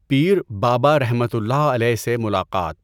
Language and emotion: Urdu, neutral